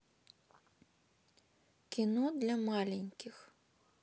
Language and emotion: Russian, neutral